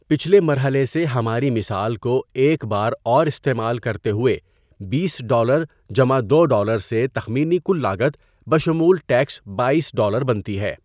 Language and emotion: Urdu, neutral